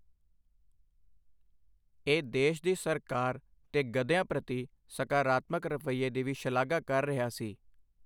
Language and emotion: Punjabi, neutral